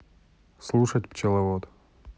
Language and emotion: Russian, neutral